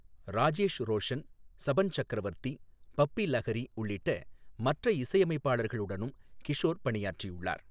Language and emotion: Tamil, neutral